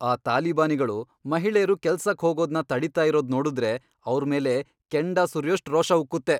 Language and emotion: Kannada, angry